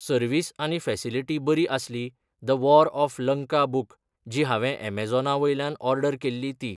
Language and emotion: Goan Konkani, neutral